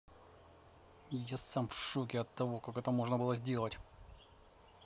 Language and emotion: Russian, angry